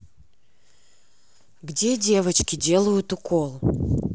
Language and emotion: Russian, angry